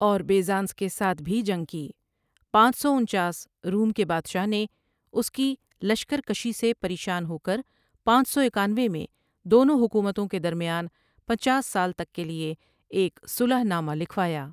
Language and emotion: Urdu, neutral